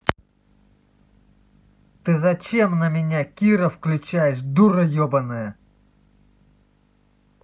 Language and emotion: Russian, angry